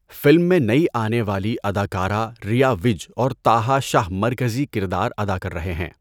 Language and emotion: Urdu, neutral